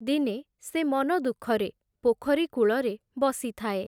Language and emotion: Odia, neutral